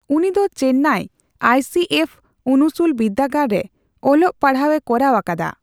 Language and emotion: Santali, neutral